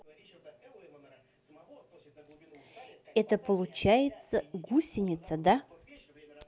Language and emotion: Russian, neutral